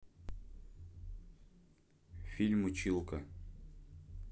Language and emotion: Russian, neutral